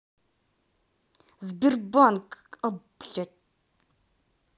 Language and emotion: Russian, angry